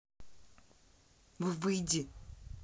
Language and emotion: Russian, angry